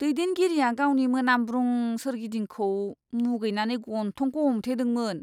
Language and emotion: Bodo, disgusted